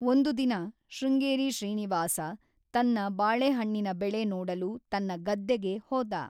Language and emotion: Kannada, neutral